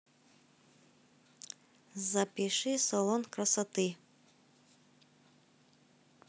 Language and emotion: Russian, neutral